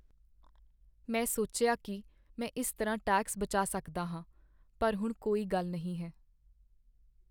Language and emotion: Punjabi, sad